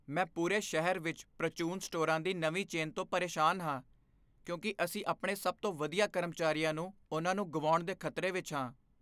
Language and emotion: Punjabi, fearful